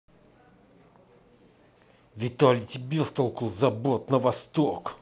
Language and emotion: Russian, angry